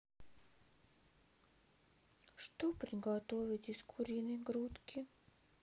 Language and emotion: Russian, sad